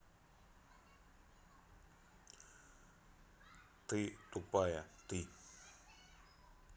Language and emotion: Russian, neutral